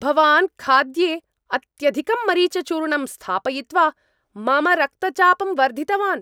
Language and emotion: Sanskrit, angry